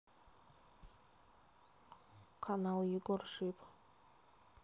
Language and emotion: Russian, neutral